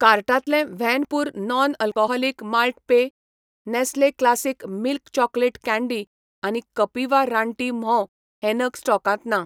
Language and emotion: Goan Konkani, neutral